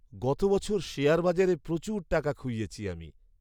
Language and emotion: Bengali, sad